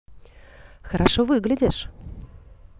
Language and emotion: Russian, positive